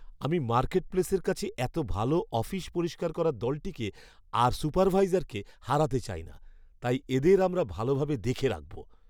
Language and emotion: Bengali, fearful